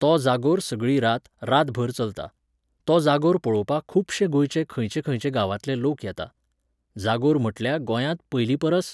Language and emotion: Goan Konkani, neutral